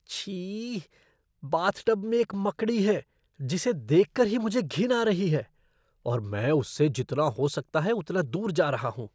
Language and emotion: Hindi, disgusted